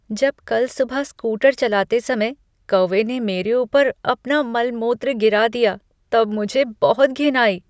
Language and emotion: Hindi, disgusted